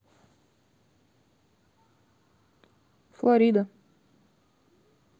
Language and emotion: Russian, neutral